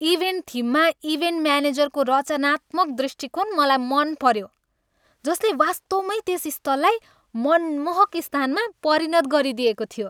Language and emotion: Nepali, happy